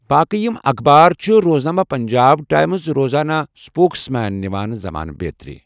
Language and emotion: Kashmiri, neutral